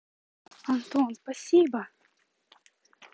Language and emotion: Russian, positive